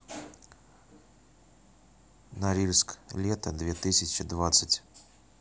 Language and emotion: Russian, neutral